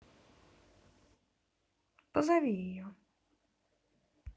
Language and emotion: Russian, neutral